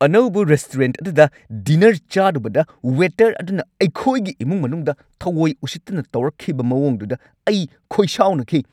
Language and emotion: Manipuri, angry